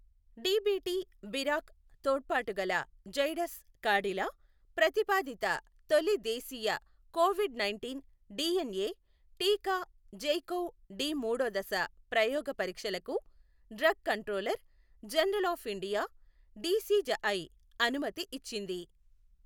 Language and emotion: Telugu, neutral